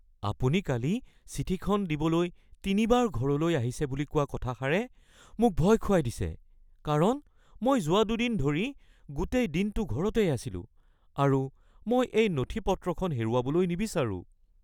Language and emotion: Assamese, fearful